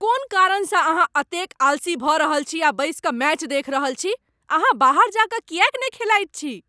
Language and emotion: Maithili, angry